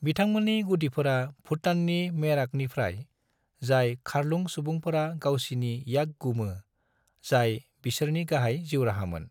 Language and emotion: Bodo, neutral